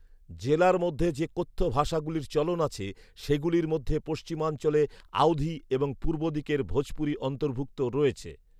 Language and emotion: Bengali, neutral